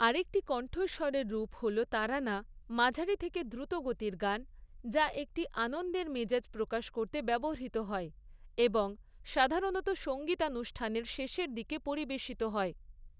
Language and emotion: Bengali, neutral